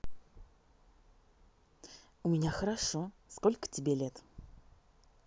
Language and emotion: Russian, positive